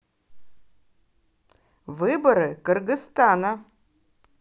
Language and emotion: Russian, positive